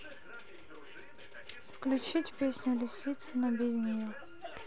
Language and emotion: Russian, neutral